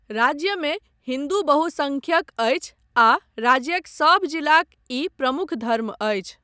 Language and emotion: Maithili, neutral